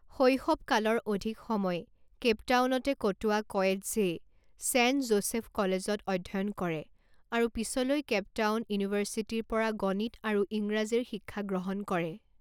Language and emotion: Assamese, neutral